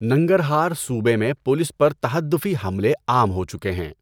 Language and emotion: Urdu, neutral